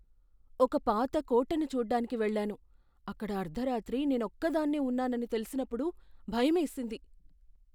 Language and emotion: Telugu, fearful